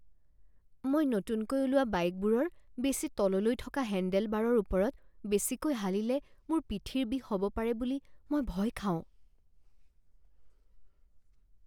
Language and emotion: Assamese, fearful